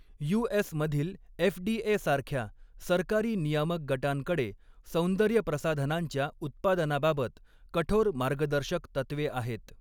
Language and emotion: Marathi, neutral